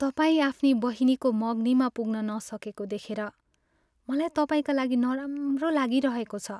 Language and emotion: Nepali, sad